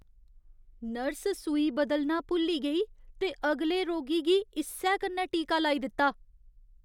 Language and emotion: Dogri, disgusted